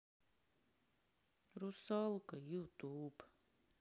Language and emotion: Russian, sad